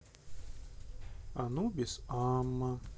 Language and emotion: Russian, neutral